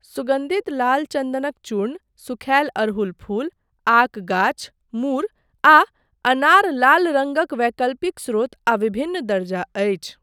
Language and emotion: Maithili, neutral